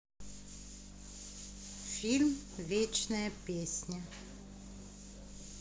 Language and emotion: Russian, neutral